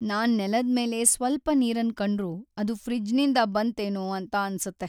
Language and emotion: Kannada, sad